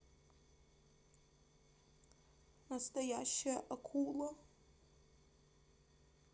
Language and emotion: Russian, sad